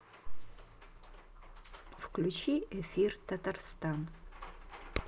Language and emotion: Russian, neutral